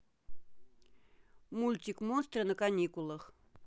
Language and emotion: Russian, neutral